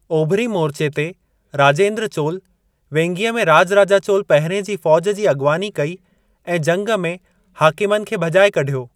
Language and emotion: Sindhi, neutral